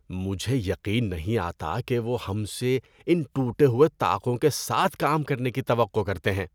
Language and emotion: Urdu, disgusted